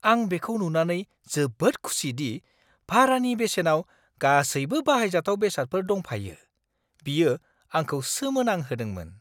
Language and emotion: Bodo, surprised